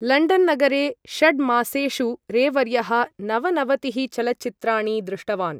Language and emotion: Sanskrit, neutral